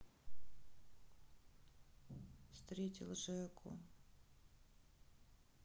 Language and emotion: Russian, sad